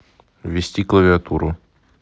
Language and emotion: Russian, neutral